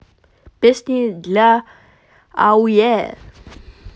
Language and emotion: Russian, positive